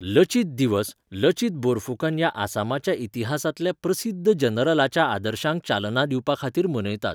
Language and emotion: Goan Konkani, neutral